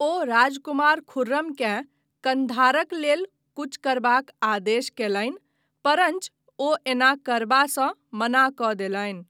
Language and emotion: Maithili, neutral